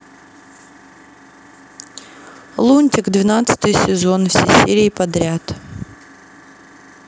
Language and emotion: Russian, neutral